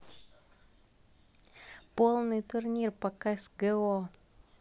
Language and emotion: Russian, neutral